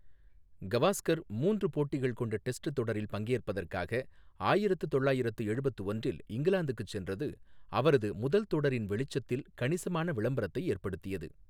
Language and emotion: Tamil, neutral